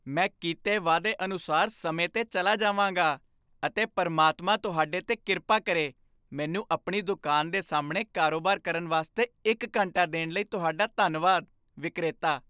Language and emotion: Punjabi, happy